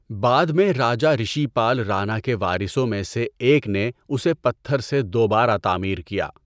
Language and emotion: Urdu, neutral